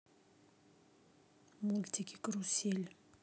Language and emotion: Russian, neutral